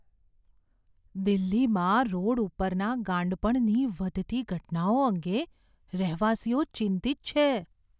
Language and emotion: Gujarati, fearful